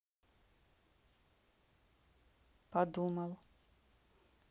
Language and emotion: Russian, neutral